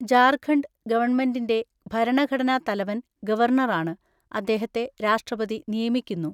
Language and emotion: Malayalam, neutral